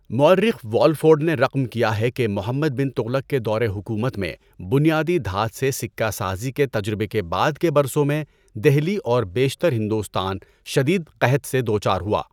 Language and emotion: Urdu, neutral